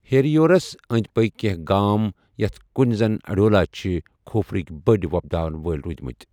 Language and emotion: Kashmiri, neutral